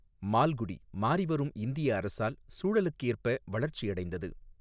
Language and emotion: Tamil, neutral